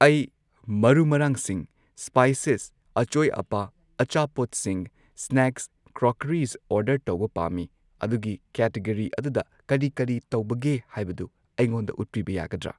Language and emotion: Manipuri, neutral